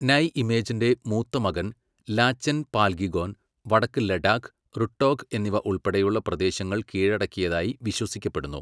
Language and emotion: Malayalam, neutral